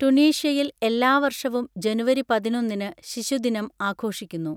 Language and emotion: Malayalam, neutral